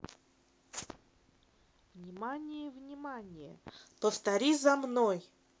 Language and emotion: Russian, neutral